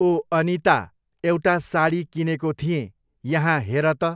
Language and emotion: Nepali, neutral